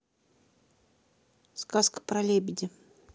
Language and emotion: Russian, neutral